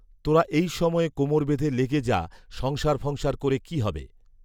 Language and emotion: Bengali, neutral